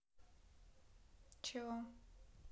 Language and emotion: Russian, neutral